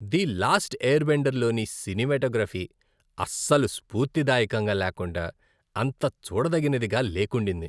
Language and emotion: Telugu, disgusted